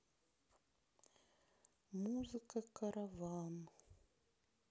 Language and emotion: Russian, sad